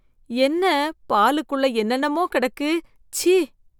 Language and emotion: Tamil, disgusted